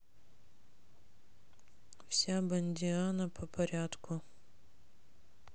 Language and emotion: Russian, sad